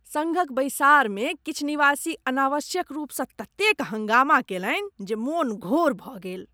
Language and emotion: Maithili, disgusted